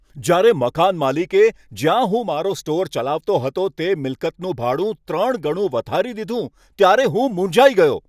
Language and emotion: Gujarati, angry